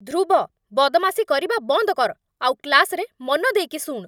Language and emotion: Odia, angry